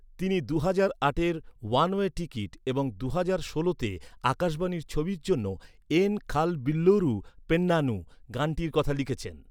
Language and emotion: Bengali, neutral